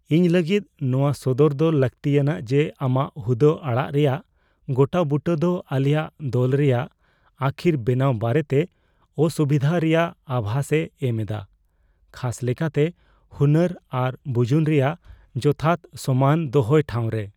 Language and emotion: Santali, fearful